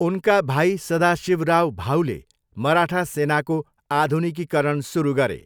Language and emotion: Nepali, neutral